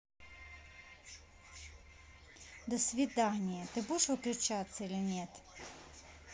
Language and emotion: Russian, angry